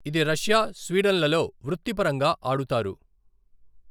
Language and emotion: Telugu, neutral